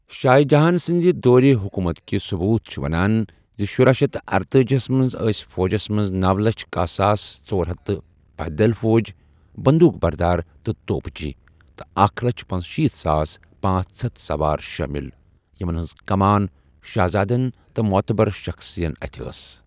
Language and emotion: Kashmiri, neutral